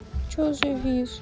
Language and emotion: Russian, sad